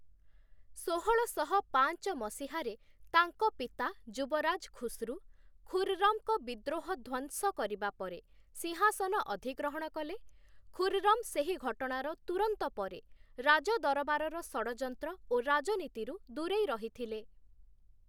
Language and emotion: Odia, neutral